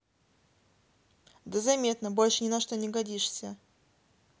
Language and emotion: Russian, neutral